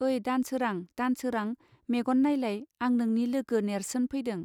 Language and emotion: Bodo, neutral